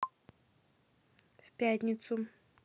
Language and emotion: Russian, neutral